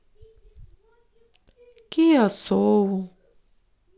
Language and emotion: Russian, sad